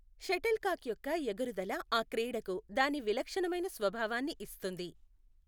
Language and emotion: Telugu, neutral